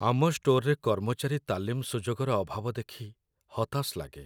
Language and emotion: Odia, sad